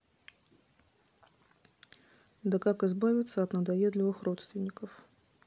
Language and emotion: Russian, neutral